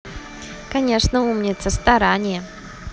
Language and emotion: Russian, positive